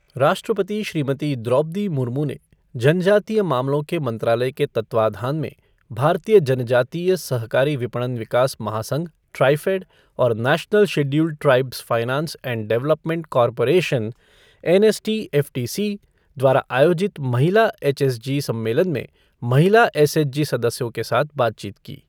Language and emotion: Hindi, neutral